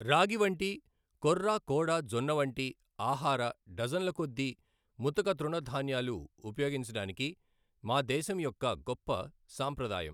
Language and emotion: Telugu, neutral